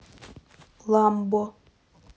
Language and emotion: Russian, neutral